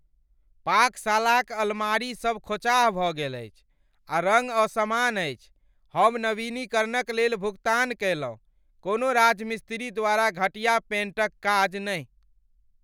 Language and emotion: Maithili, angry